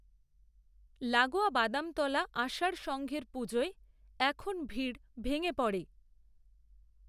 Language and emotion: Bengali, neutral